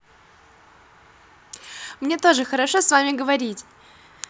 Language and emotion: Russian, positive